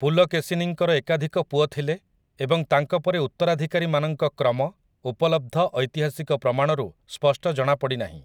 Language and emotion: Odia, neutral